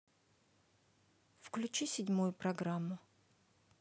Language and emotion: Russian, neutral